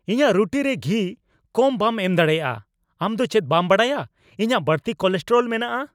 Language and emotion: Santali, angry